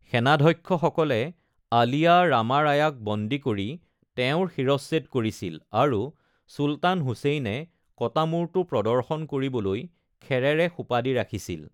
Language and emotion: Assamese, neutral